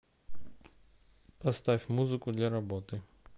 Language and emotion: Russian, neutral